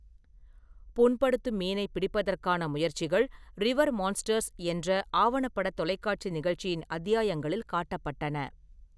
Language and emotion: Tamil, neutral